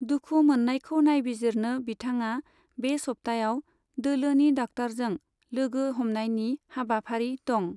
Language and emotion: Bodo, neutral